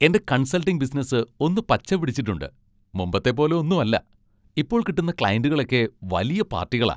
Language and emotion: Malayalam, happy